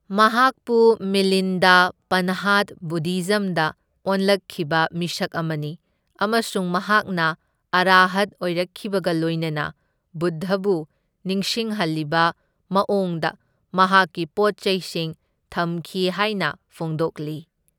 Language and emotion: Manipuri, neutral